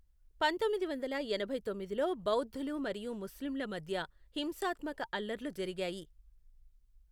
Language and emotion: Telugu, neutral